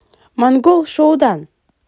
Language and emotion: Russian, positive